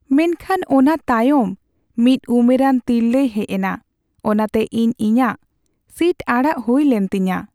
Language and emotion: Santali, sad